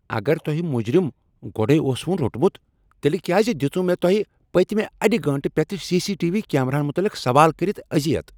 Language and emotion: Kashmiri, angry